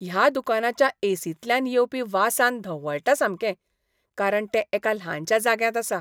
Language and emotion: Goan Konkani, disgusted